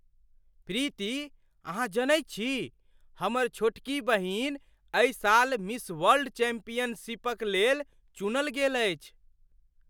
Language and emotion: Maithili, surprised